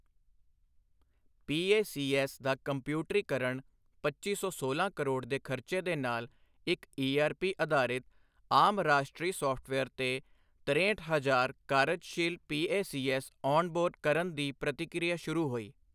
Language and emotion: Punjabi, neutral